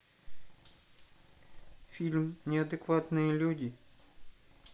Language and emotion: Russian, neutral